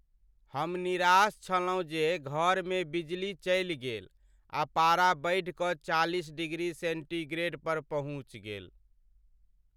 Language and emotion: Maithili, sad